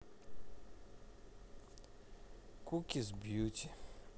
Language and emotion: Russian, sad